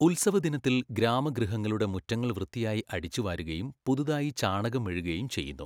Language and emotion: Malayalam, neutral